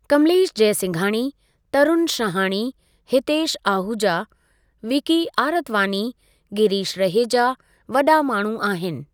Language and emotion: Sindhi, neutral